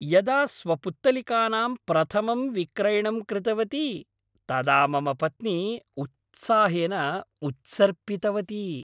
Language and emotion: Sanskrit, happy